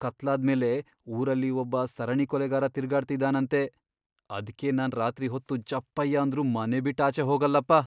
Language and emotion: Kannada, fearful